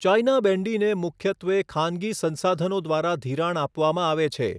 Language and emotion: Gujarati, neutral